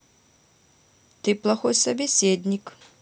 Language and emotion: Russian, neutral